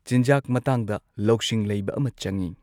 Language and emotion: Manipuri, neutral